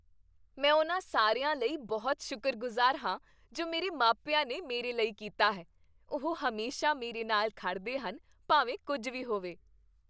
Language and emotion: Punjabi, happy